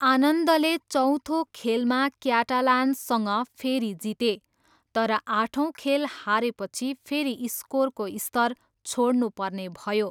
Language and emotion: Nepali, neutral